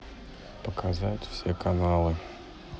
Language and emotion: Russian, neutral